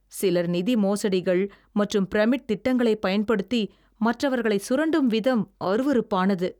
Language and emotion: Tamil, disgusted